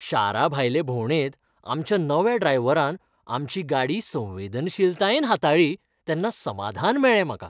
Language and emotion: Goan Konkani, happy